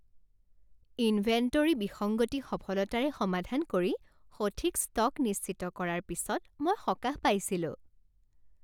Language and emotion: Assamese, happy